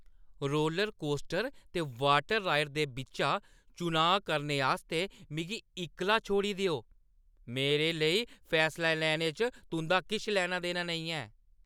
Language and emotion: Dogri, angry